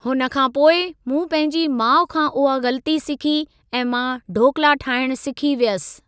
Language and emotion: Sindhi, neutral